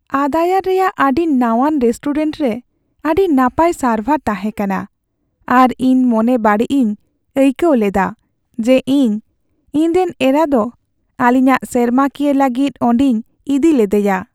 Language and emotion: Santali, sad